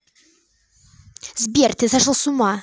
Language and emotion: Russian, angry